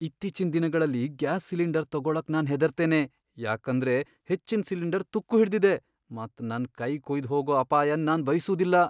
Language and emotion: Kannada, fearful